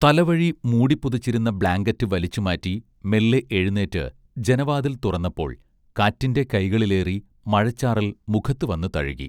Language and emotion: Malayalam, neutral